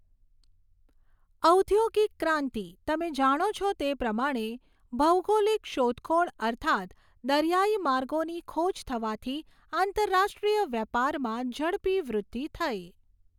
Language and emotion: Gujarati, neutral